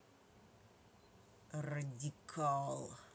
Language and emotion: Russian, angry